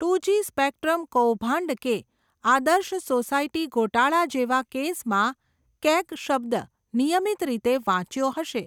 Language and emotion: Gujarati, neutral